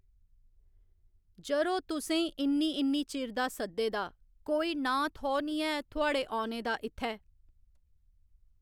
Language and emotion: Dogri, neutral